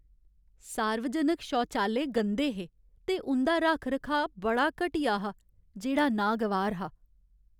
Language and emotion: Dogri, sad